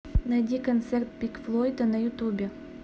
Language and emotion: Russian, neutral